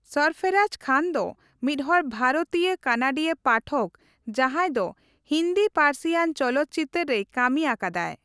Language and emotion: Santali, neutral